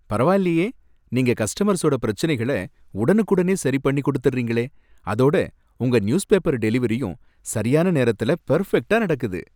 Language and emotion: Tamil, happy